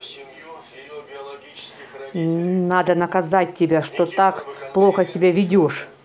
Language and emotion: Russian, angry